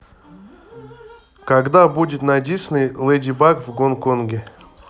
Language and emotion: Russian, neutral